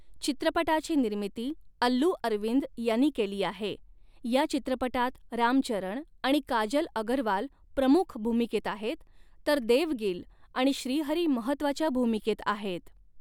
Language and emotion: Marathi, neutral